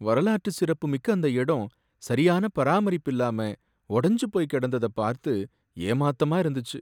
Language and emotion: Tamil, sad